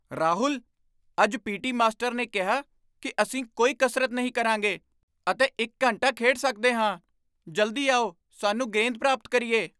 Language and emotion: Punjabi, surprised